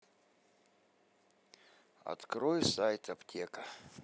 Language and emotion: Russian, sad